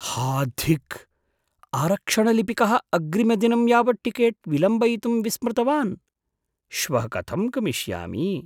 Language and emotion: Sanskrit, surprised